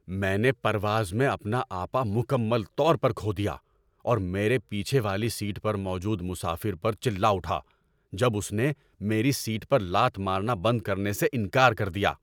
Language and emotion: Urdu, angry